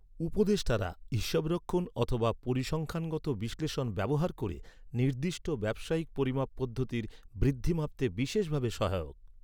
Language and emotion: Bengali, neutral